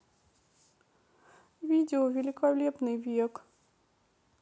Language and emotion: Russian, sad